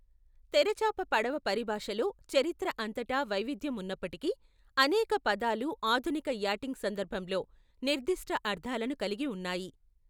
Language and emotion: Telugu, neutral